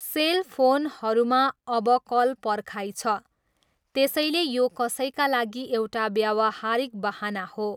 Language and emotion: Nepali, neutral